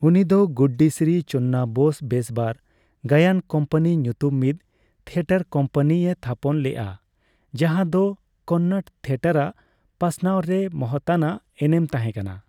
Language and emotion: Santali, neutral